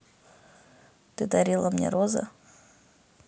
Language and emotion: Russian, neutral